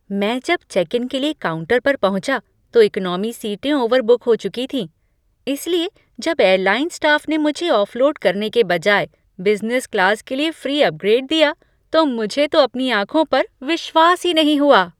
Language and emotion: Hindi, surprised